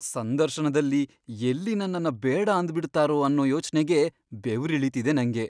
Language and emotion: Kannada, fearful